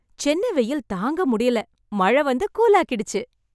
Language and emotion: Tamil, happy